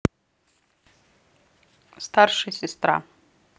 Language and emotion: Russian, neutral